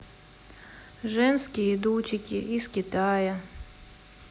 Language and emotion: Russian, sad